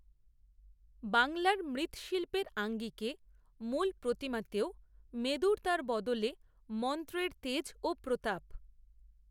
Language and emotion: Bengali, neutral